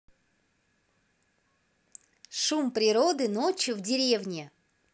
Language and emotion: Russian, positive